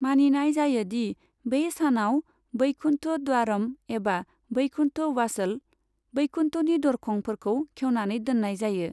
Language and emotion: Bodo, neutral